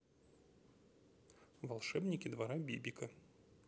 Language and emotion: Russian, neutral